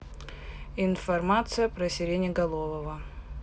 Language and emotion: Russian, neutral